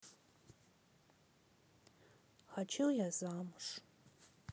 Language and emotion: Russian, sad